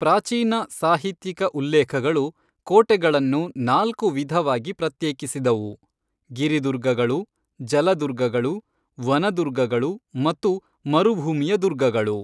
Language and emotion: Kannada, neutral